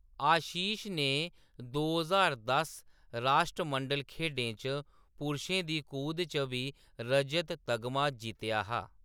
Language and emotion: Dogri, neutral